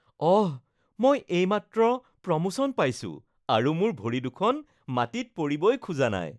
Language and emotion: Assamese, happy